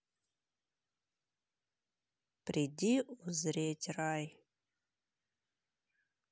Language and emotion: Russian, neutral